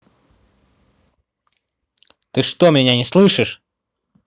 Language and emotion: Russian, angry